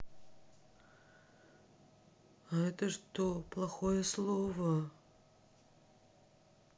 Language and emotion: Russian, sad